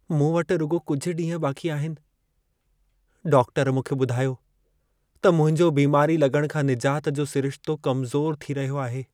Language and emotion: Sindhi, sad